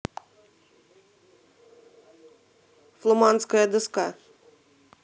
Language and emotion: Russian, neutral